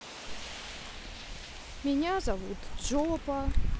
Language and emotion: Russian, neutral